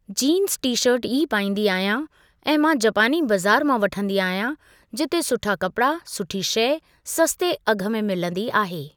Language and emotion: Sindhi, neutral